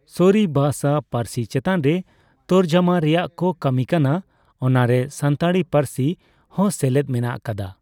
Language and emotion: Santali, neutral